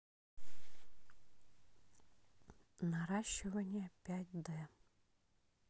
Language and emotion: Russian, neutral